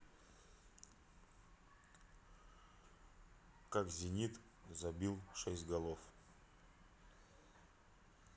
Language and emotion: Russian, neutral